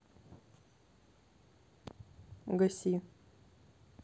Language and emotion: Russian, neutral